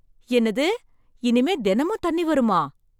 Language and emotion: Tamil, surprised